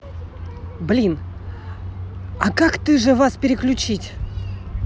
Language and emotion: Russian, angry